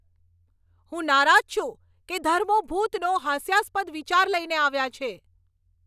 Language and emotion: Gujarati, angry